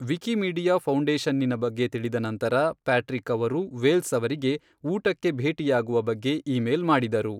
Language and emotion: Kannada, neutral